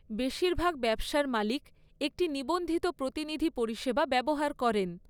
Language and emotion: Bengali, neutral